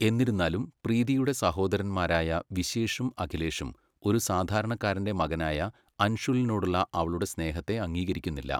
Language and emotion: Malayalam, neutral